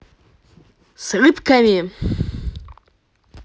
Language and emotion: Russian, positive